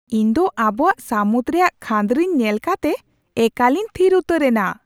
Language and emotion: Santali, surprised